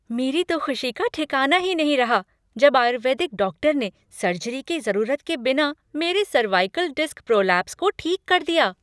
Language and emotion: Hindi, happy